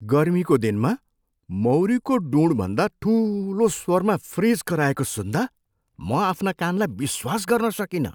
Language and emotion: Nepali, surprised